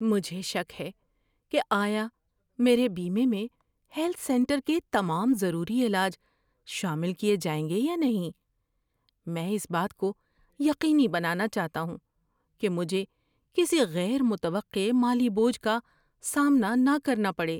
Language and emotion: Urdu, fearful